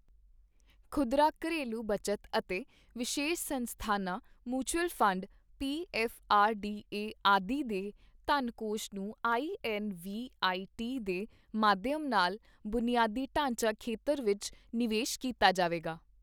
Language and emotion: Punjabi, neutral